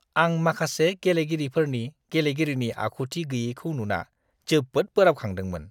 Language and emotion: Bodo, disgusted